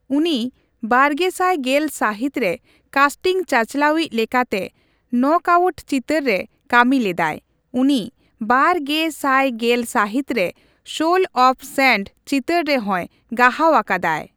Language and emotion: Santali, neutral